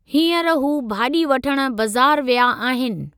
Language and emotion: Sindhi, neutral